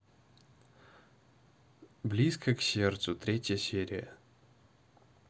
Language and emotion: Russian, neutral